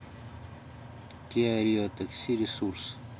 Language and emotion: Russian, neutral